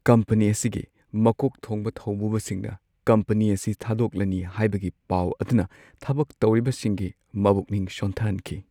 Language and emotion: Manipuri, sad